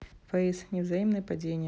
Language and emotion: Russian, neutral